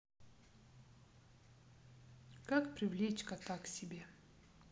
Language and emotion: Russian, neutral